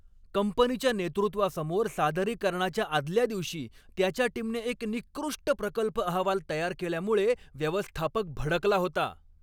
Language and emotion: Marathi, angry